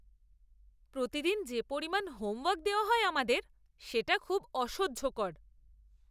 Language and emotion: Bengali, disgusted